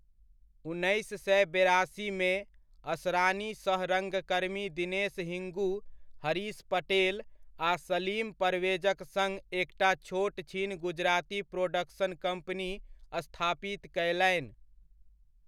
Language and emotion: Maithili, neutral